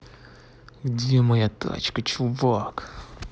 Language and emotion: Russian, angry